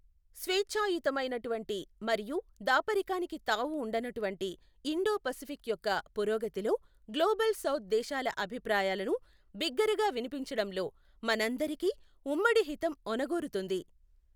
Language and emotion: Telugu, neutral